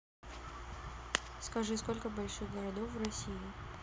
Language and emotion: Russian, neutral